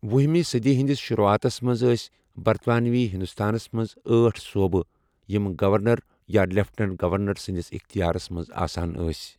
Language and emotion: Kashmiri, neutral